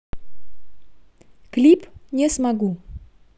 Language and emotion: Russian, neutral